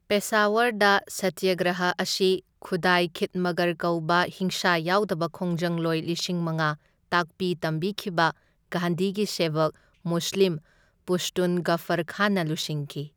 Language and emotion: Manipuri, neutral